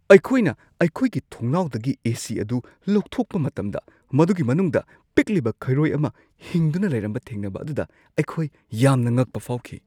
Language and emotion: Manipuri, surprised